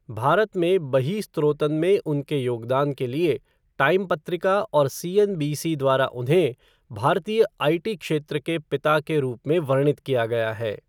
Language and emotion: Hindi, neutral